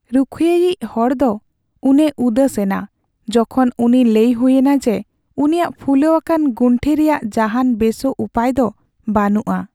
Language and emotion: Santali, sad